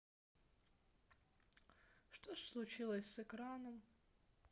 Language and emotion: Russian, sad